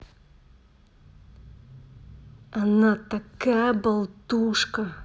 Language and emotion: Russian, angry